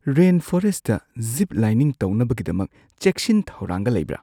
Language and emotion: Manipuri, fearful